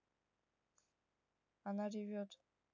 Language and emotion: Russian, neutral